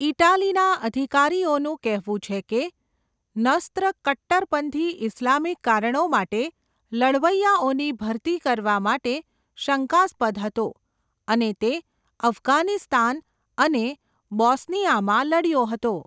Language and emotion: Gujarati, neutral